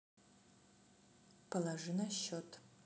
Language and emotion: Russian, neutral